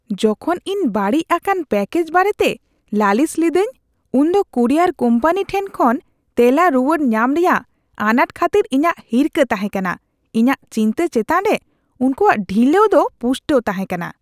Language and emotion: Santali, disgusted